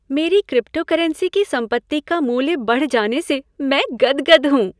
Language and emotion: Hindi, happy